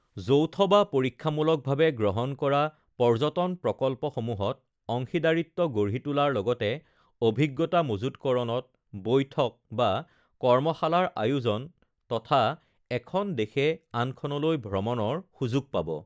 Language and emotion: Assamese, neutral